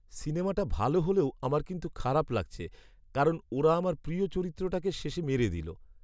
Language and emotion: Bengali, sad